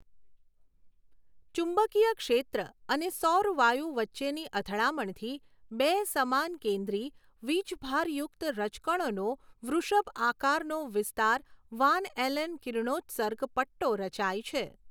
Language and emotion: Gujarati, neutral